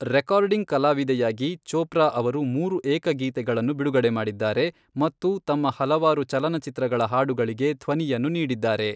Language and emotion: Kannada, neutral